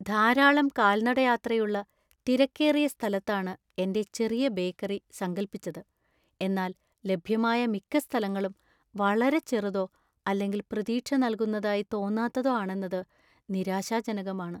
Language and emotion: Malayalam, sad